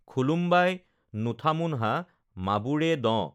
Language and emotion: Assamese, neutral